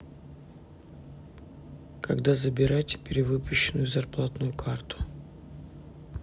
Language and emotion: Russian, neutral